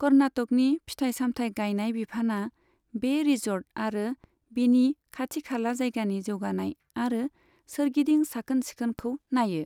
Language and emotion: Bodo, neutral